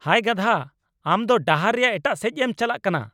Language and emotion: Santali, angry